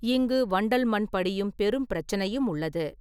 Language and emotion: Tamil, neutral